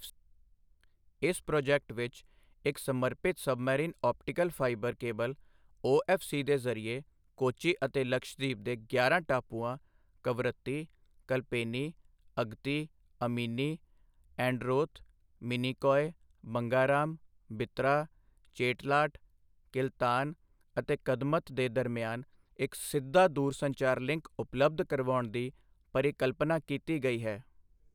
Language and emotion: Punjabi, neutral